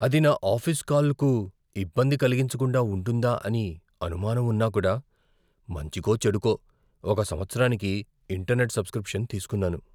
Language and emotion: Telugu, fearful